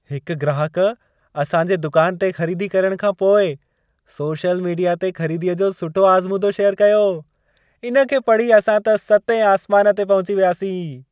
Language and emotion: Sindhi, happy